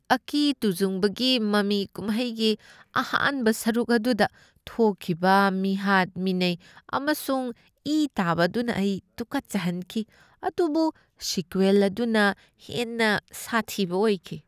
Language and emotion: Manipuri, disgusted